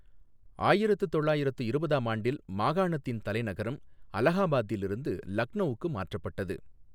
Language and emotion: Tamil, neutral